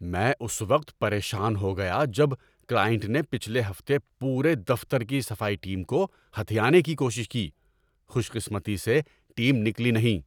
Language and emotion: Urdu, angry